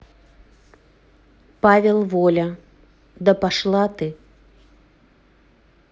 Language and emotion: Russian, neutral